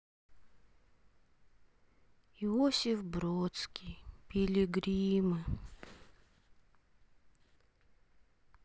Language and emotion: Russian, sad